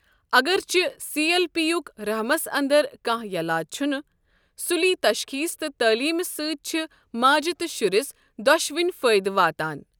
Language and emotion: Kashmiri, neutral